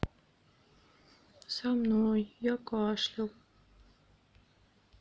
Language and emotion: Russian, sad